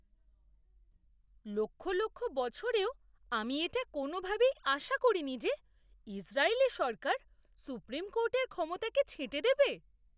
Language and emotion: Bengali, surprised